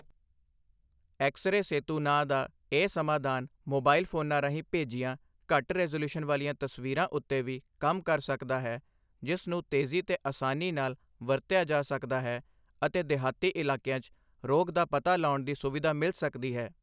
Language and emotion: Punjabi, neutral